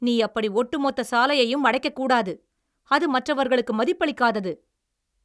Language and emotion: Tamil, angry